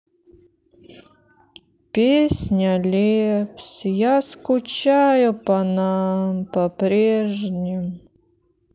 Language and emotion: Russian, sad